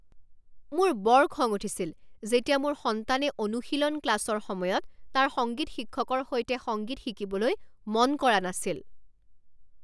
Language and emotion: Assamese, angry